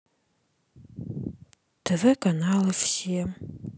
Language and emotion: Russian, sad